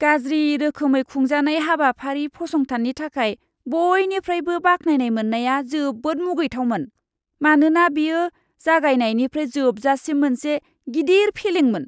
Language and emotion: Bodo, disgusted